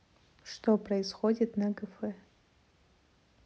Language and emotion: Russian, neutral